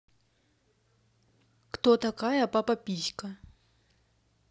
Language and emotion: Russian, neutral